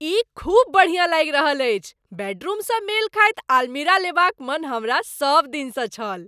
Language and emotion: Maithili, happy